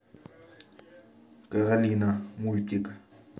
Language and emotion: Russian, neutral